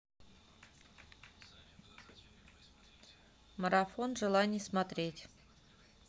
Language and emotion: Russian, neutral